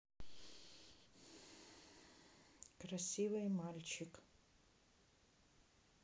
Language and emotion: Russian, neutral